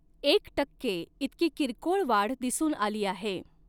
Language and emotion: Marathi, neutral